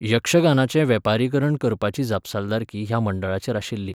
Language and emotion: Goan Konkani, neutral